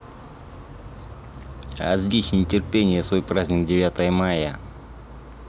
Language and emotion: Russian, neutral